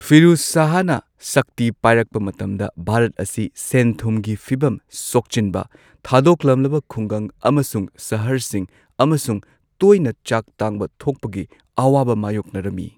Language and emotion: Manipuri, neutral